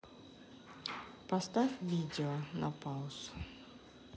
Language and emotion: Russian, neutral